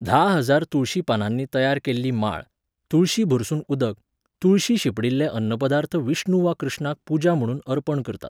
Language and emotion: Goan Konkani, neutral